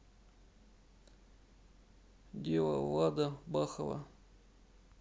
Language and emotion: Russian, sad